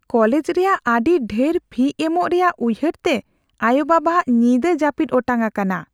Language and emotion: Santali, fearful